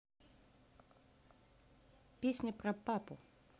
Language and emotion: Russian, neutral